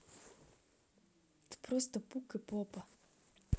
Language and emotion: Russian, neutral